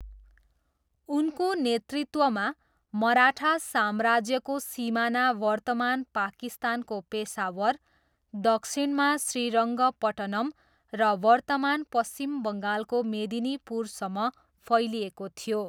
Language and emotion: Nepali, neutral